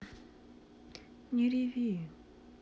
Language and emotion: Russian, sad